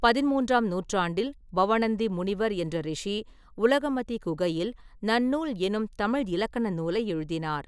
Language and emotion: Tamil, neutral